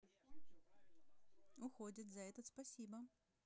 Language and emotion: Russian, positive